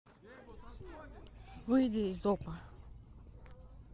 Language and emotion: Russian, neutral